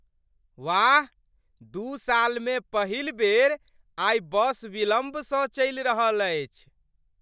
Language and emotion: Maithili, surprised